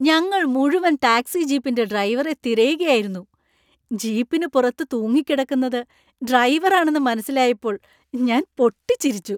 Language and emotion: Malayalam, happy